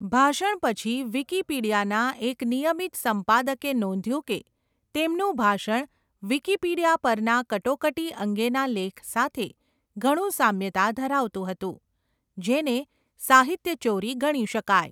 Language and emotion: Gujarati, neutral